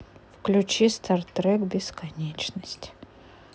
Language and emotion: Russian, neutral